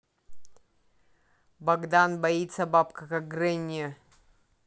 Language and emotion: Russian, neutral